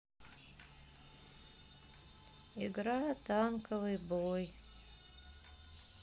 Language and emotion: Russian, sad